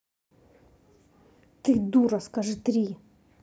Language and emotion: Russian, angry